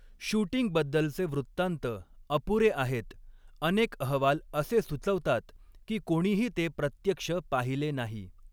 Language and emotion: Marathi, neutral